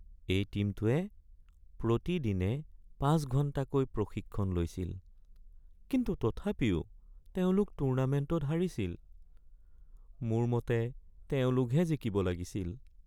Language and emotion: Assamese, sad